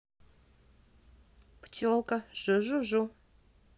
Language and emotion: Russian, positive